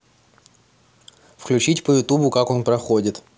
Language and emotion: Russian, neutral